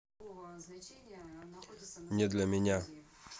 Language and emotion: Russian, neutral